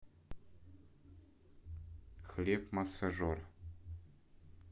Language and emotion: Russian, neutral